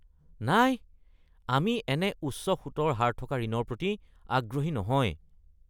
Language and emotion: Assamese, disgusted